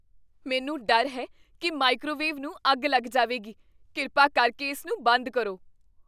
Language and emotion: Punjabi, fearful